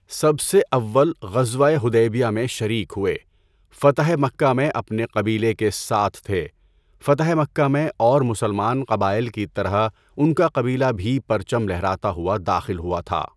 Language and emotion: Urdu, neutral